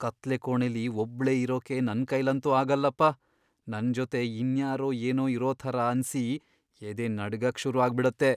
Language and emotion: Kannada, fearful